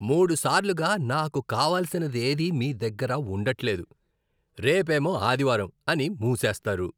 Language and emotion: Telugu, disgusted